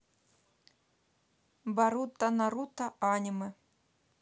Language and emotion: Russian, neutral